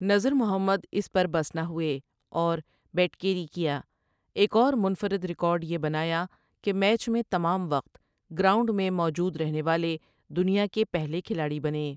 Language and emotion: Urdu, neutral